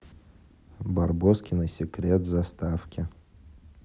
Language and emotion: Russian, neutral